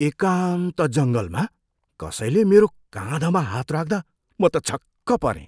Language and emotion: Nepali, surprised